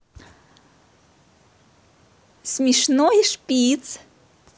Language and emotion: Russian, positive